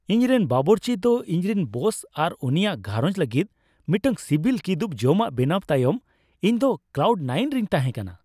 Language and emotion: Santali, happy